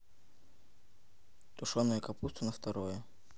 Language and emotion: Russian, neutral